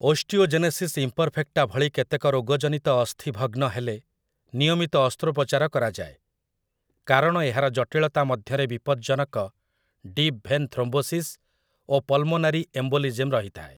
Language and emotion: Odia, neutral